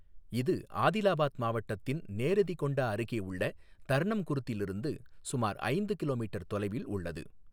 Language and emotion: Tamil, neutral